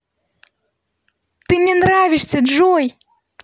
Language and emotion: Russian, positive